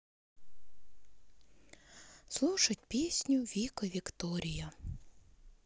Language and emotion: Russian, sad